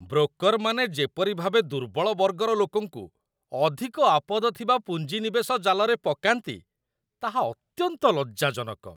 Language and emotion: Odia, disgusted